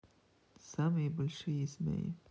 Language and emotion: Russian, neutral